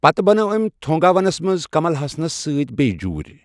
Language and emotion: Kashmiri, neutral